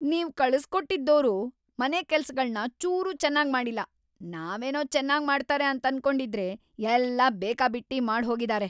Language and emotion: Kannada, angry